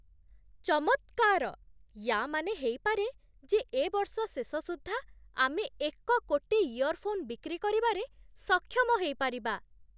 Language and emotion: Odia, surprised